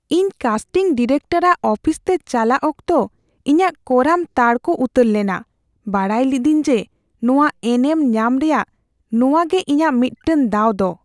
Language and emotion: Santali, fearful